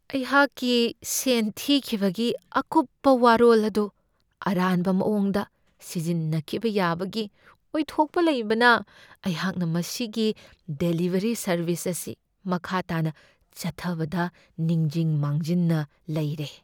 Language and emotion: Manipuri, fearful